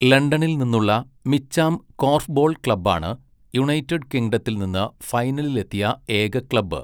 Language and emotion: Malayalam, neutral